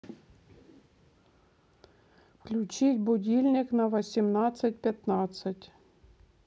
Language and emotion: Russian, neutral